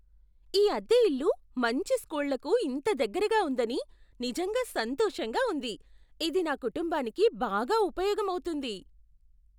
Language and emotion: Telugu, surprised